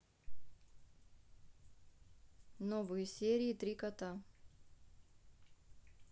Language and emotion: Russian, neutral